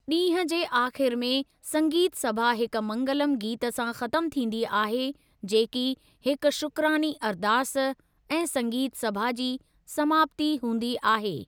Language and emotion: Sindhi, neutral